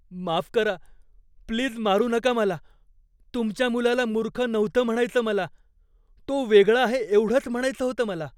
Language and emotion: Marathi, fearful